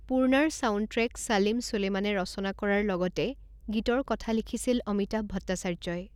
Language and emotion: Assamese, neutral